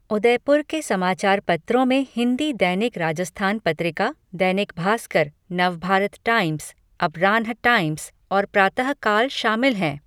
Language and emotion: Hindi, neutral